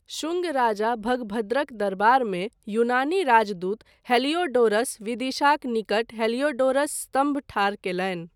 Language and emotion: Maithili, neutral